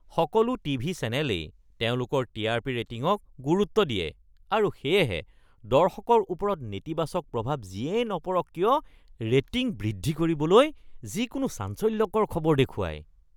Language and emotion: Assamese, disgusted